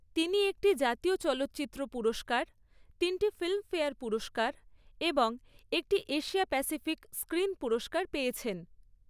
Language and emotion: Bengali, neutral